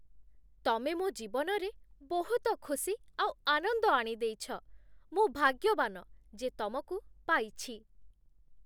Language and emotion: Odia, happy